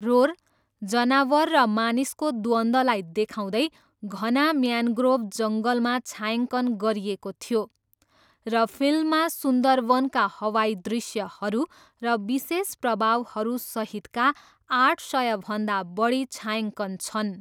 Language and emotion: Nepali, neutral